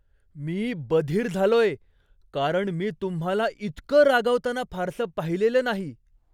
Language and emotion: Marathi, surprised